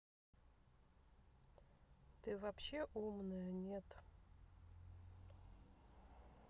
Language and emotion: Russian, neutral